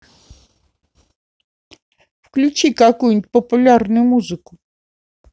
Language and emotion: Russian, neutral